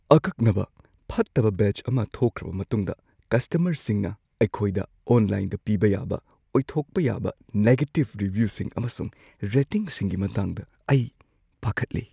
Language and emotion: Manipuri, fearful